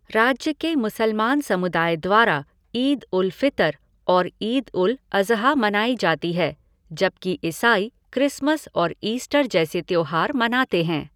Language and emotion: Hindi, neutral